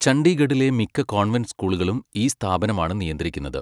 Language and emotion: Malayalam, neutral